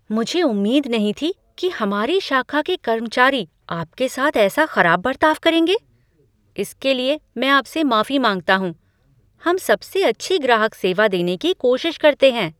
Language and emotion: Hindi, surprised